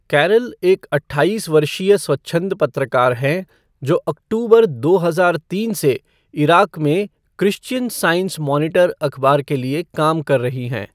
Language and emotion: Hindi, neutral